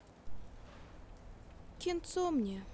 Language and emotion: Russian, sad